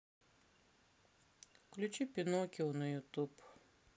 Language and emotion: Russian, sad